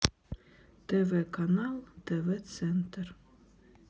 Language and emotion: Russian, sad